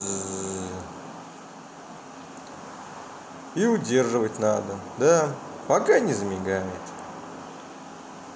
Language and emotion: Russian, positive